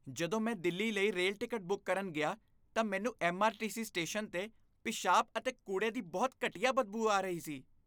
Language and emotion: Punjabi, disgusted